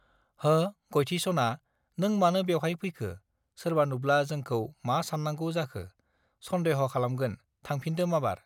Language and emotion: Bodo, neutral